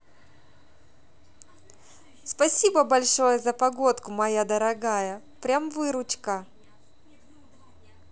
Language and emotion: Russian, positive